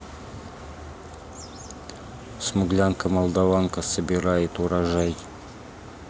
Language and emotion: Russian, neutral